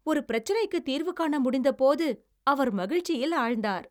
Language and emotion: Tamil, happy